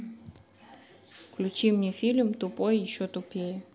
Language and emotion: Russian, neutral